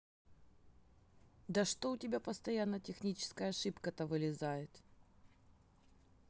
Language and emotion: Russian, angry